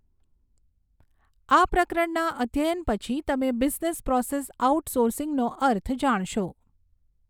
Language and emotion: Gujarati, neutral